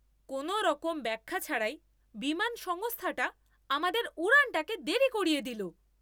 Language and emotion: Bengali, angry